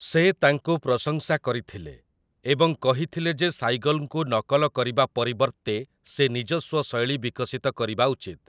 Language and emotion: Odia, neutral